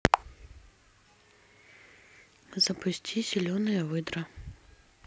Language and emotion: Russian, neutral